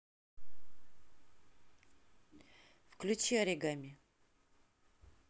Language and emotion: Russian, neutral